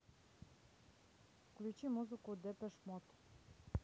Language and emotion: Russian, neutral